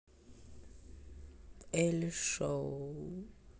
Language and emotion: Russian, sad